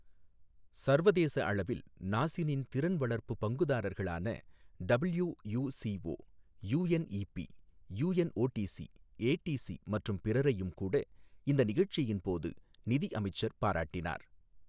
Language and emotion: Tamil, neutral